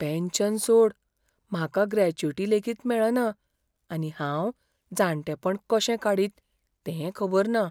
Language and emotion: Goan Konkani, fearful